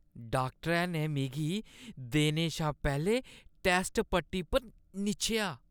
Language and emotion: Dogri, disgusted